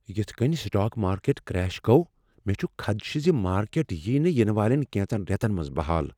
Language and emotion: Kashmiri, fearful